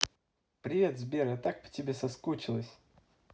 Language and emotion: Russian, positive